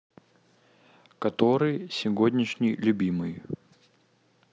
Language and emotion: Russian, neutral